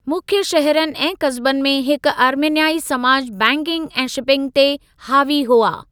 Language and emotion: Sindhi, neutral